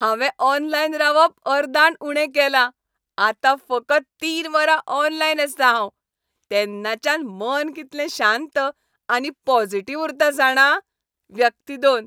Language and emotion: Goan Konkani, happy